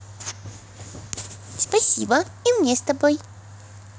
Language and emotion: Russian, positive